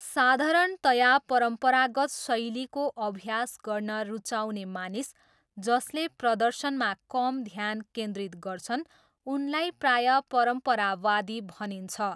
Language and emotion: Nepali, neutral